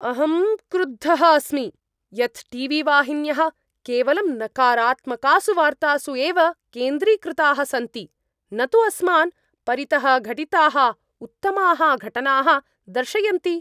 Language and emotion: Sanskrit, angry